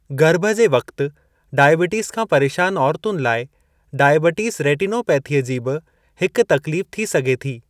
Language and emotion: Sindhi, neutral